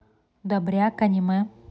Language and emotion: Russian, neutral